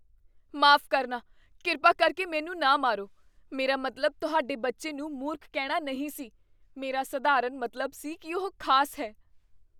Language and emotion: Punjabi, fearful